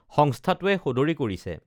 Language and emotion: Assamese, neutral